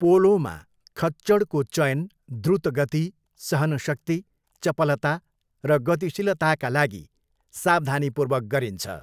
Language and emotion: Nepali, neutral